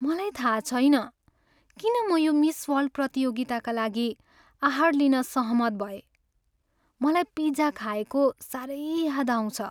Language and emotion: Nepali, sad